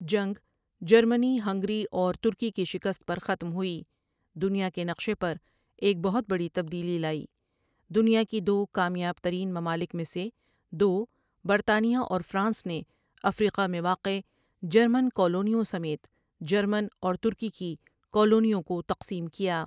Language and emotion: Urdu, neutral